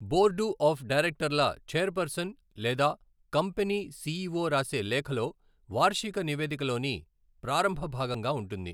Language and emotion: Telugu, neutral